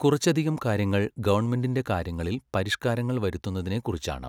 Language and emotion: Malayalam, neutral